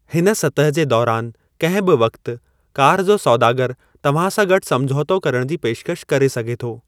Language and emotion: Sindhi, neutral